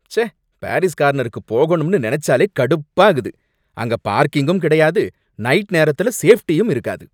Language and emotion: Tamil, angry